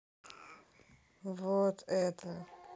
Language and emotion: Russian, sad